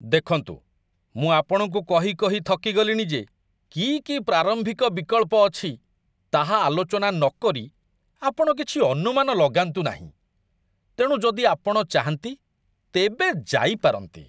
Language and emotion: Odia, disgusted